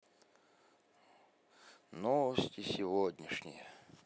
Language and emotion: Russian, sad